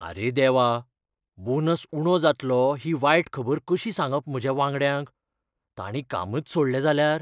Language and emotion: Goan Konkani, fearful